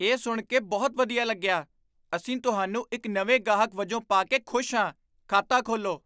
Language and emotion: Punjabi, surprised